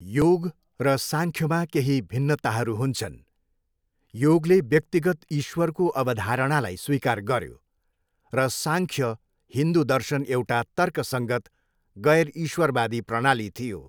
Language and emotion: Nepali, neutral